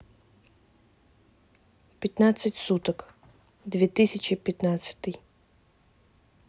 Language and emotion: Russian, neutral